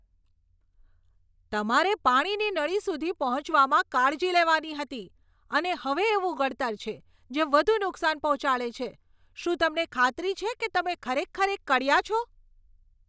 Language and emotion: Gujarati, angry